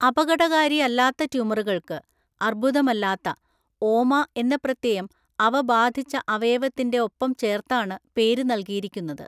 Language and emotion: Malayalam, neutral